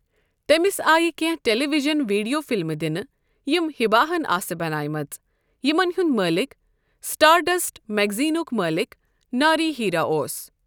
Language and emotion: Kashmiri, neutral